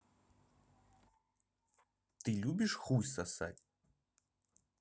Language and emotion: Russian, neutral